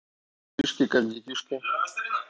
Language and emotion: Russian, neutral